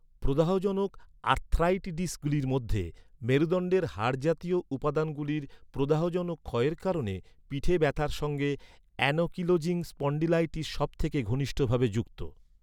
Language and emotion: Bengali, neutral